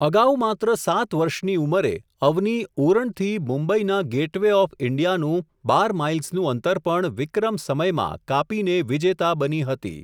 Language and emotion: Gujarati, neutral